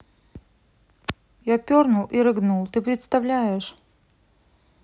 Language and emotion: Russian, neutral